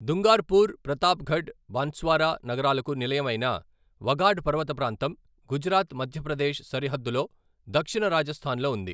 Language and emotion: Telugu, neutral